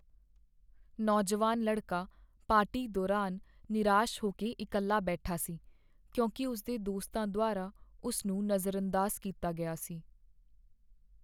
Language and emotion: Punjabi, sad